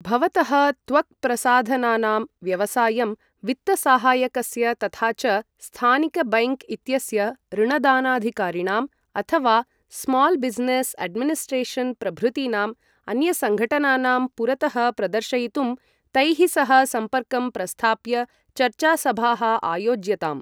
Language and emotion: Sanskrit, neutral